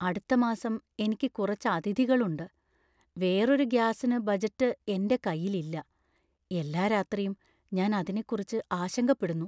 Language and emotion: Malayalam, fearful